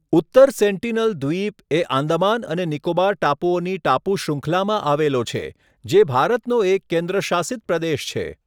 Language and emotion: Gujarati, neutral